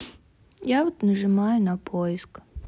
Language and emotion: Russian, neutral